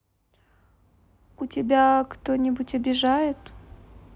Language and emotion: Russian, neutral